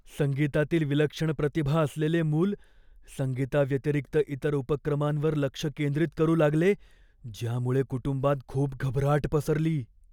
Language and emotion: Marathi, fearful